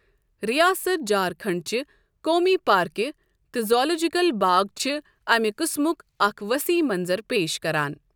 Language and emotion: Kashmiri, neutral